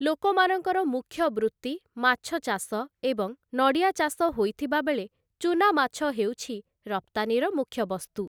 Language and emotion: Odia, neutral